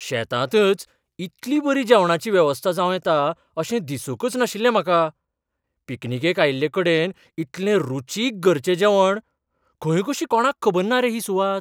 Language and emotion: Goan Konkani, surprised